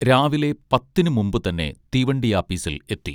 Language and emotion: Malayalam, neutral